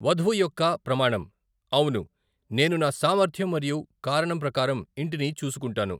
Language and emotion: Telugu, neutral